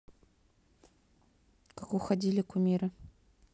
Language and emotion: Russian, neutral